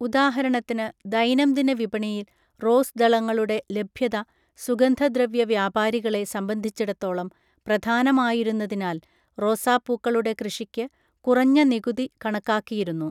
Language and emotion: Malayalam, neutral